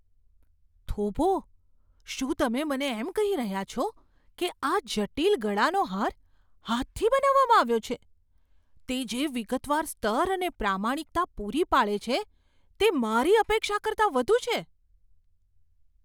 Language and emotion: Gujarati, surprised